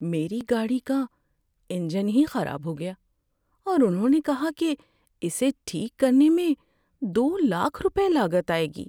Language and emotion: Urdu, sad